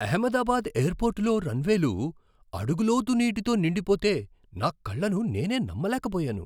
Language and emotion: Telugu, surprised